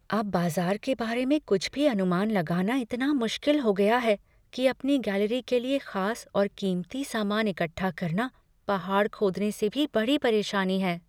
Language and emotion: Hindi, fearful